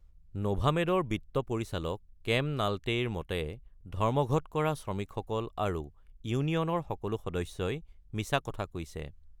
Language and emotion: Assamese, neutral